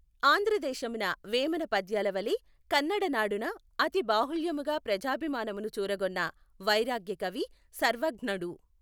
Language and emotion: Telugu, neutral